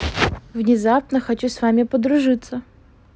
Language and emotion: Russian, positive